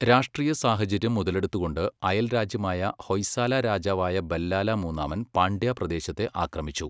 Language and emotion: Malayalam, neutral